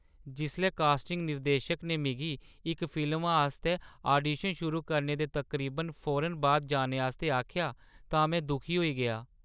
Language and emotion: Dogri, sad